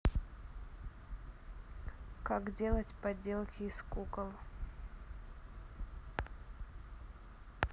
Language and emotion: Russian, neutral